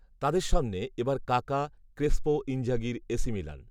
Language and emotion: Bengali, neutral